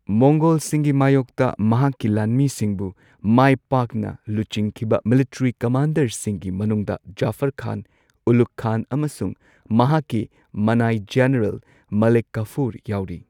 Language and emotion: Manipuri, neutral